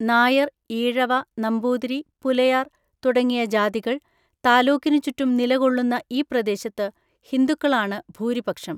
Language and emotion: Malayalam, neutral